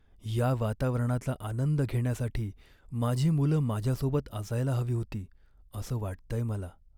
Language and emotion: Marathi, sad